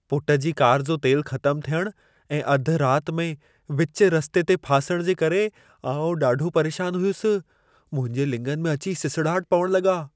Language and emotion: Sindhi, fearful